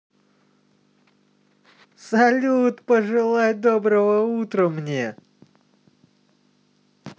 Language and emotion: Russian, positive